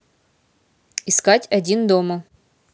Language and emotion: Russian, neutral